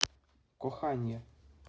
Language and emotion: Russian, neutral